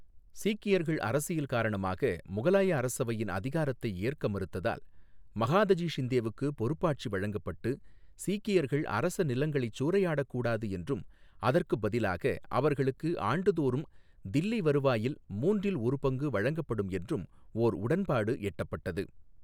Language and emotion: Tamil, neutral